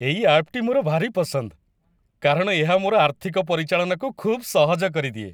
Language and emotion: Odia, happy